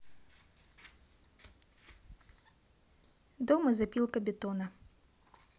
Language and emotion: Russian, neutral